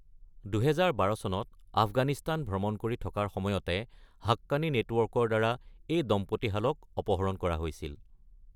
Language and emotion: Assamese, neutral